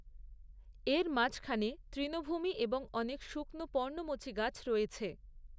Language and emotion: Bengali, neutral